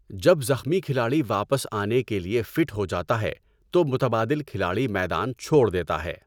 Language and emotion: Urdu, neutral